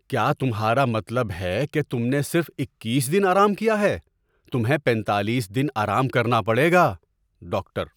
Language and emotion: Urdu, surprised